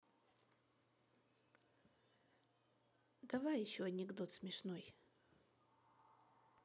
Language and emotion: Russian, neutral